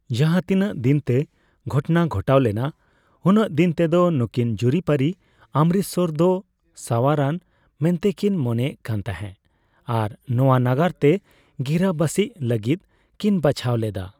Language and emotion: Santali, neutral